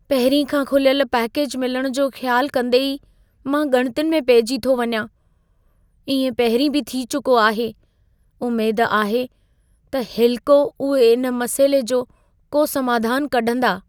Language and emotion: Sindhi, fearful